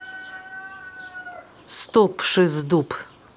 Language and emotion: Russian, neutral